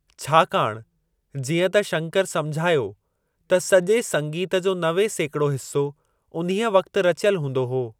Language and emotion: Sindhi, neutral